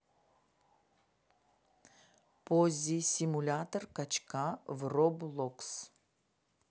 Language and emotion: Russian, neutral